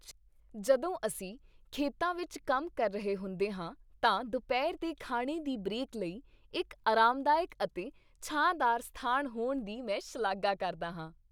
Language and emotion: Punjabi, happy